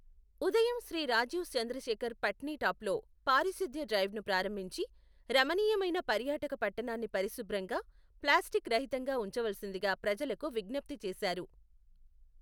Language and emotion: Telugu, neutral